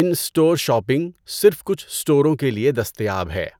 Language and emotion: Urdu, neutral